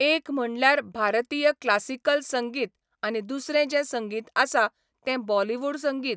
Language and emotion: Goan Konkani, neutral